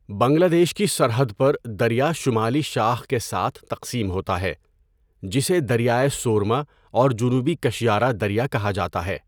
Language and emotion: Urdu, neutral